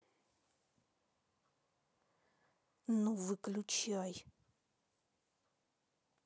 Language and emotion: Russian, angry